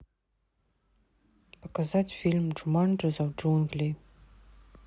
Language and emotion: Russian, neutral